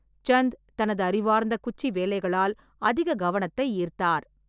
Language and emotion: Tamil, neutral